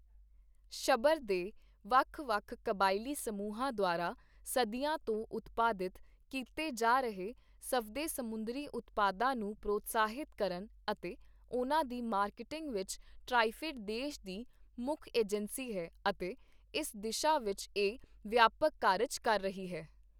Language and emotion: Punjabi, neutral